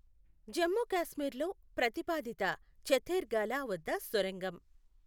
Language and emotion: Telugu, neutral